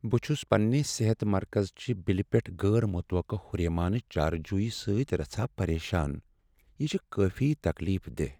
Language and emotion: Kashmiri, sad